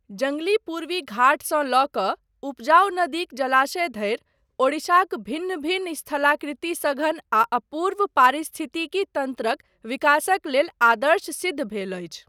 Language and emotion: Maithili, neutral